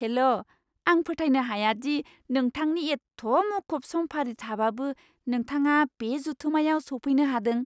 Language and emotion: Bodo, surprised